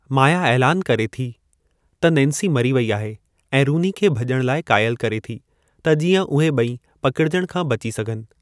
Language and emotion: Sindhi, neutral